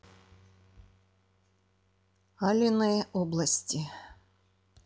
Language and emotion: Russian, neutral